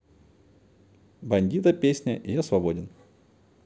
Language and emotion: Russian, neutral